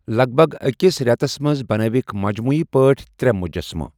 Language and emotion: Kashmiri, neutral